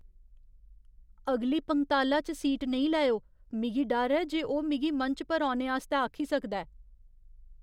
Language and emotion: Dogri, fearful